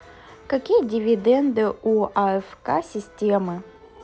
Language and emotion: Russian, neutral